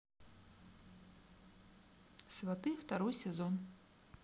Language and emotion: Russian, neutral